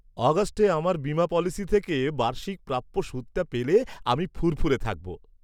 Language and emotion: Bengali, happy